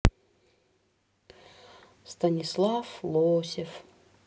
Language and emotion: Russian, sad